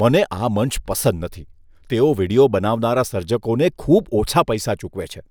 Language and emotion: Gujarati, disgusted